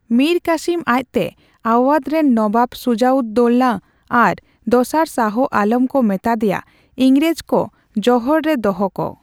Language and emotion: Santali, neutral